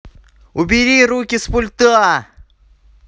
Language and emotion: Russian, angry